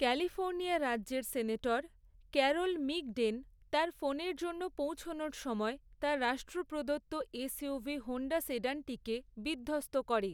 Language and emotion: Bengali, neutral